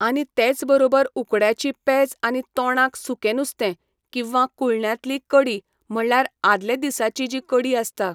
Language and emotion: Goan Konkani, neutral